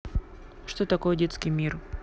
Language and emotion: Russian, neutral